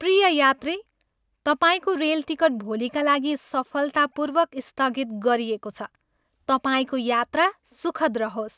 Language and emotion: Nepali, happy